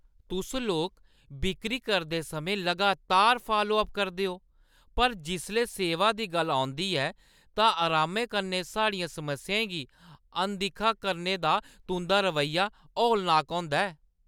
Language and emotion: Dogri, disgusted